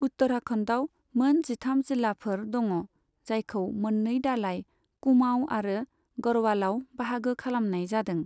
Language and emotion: Bodo, neutral